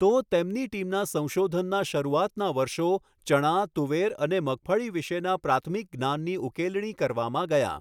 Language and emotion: Gujarati, neutral